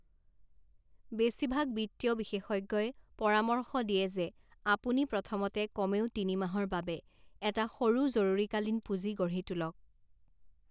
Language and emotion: Assamese, neutral